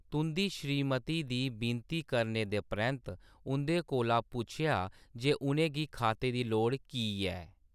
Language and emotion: Dogri, neutral